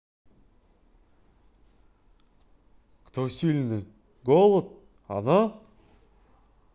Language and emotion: Russian, neutral